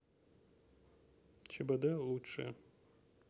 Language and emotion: Russian, neutral